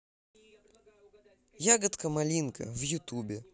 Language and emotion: Russian, positive